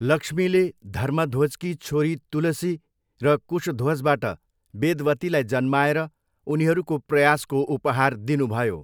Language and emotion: Nepali, neutral